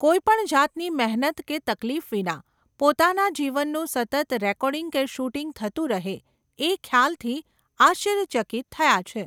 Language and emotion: Gujarati, neutral